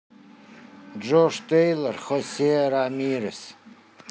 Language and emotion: Russian, neutral